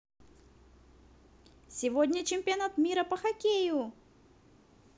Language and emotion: Russian, positive